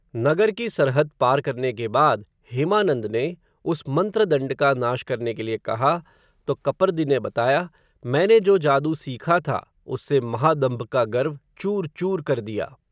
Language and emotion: Hindi, neutral